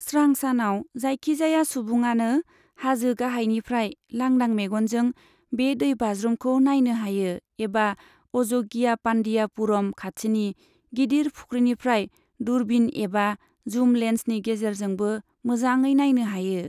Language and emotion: Bodo, neutral